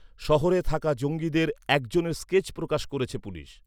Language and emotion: Bengali, neutral